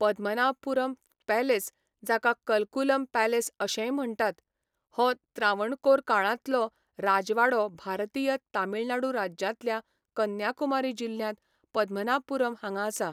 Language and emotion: Goan Konkani, neutral